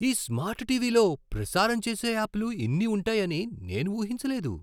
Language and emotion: Telugu, surprised